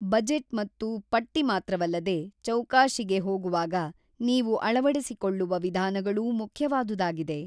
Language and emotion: Kannada, neutral